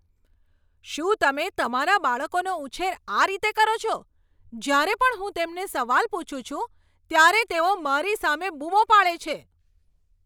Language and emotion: Gujarati, angry